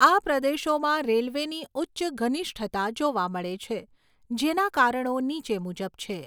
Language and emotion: Gujarati, neutral